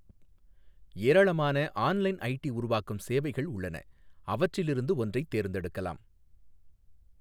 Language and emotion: Tamil, neutral